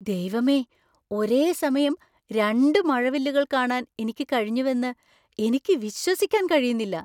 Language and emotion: Malayalam, surprised